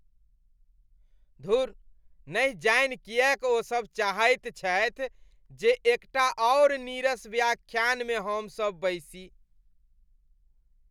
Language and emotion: Maithili, disgusted